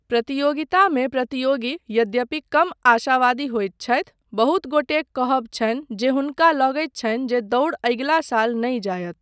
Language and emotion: Maithili, neutral